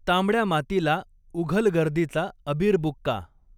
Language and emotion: Marathi, neutral